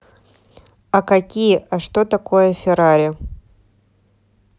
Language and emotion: Russian, neutral